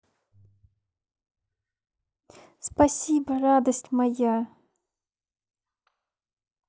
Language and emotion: Russian, positive